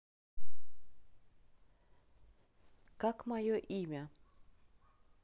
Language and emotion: Russian, neutral